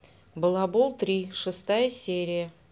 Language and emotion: Russian, neutral